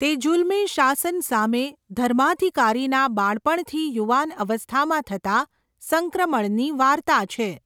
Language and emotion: Gujarati, neutral